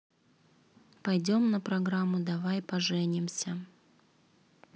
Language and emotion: Russian, neutral